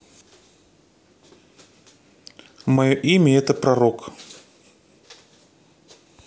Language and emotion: Russian, neutral